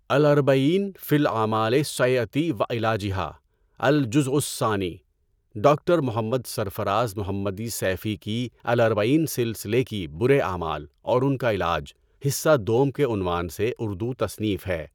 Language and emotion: Urdu, neutral